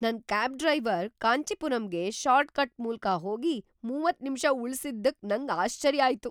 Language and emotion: Kannada, surprised